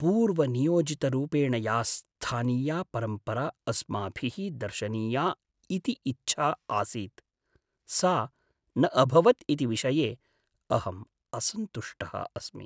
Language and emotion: Sanskrit, sad